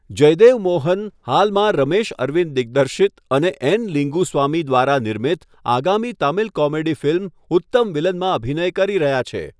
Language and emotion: Gujarati, neutral